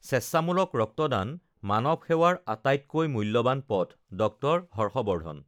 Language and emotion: Assamese, neutral